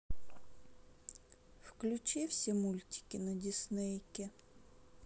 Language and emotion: Russian, sad